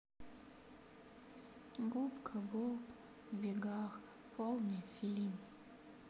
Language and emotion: Russian, sad